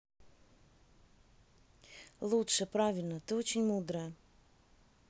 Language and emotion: Russian, neutral